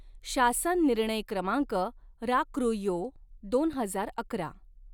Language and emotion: Marathi, neutral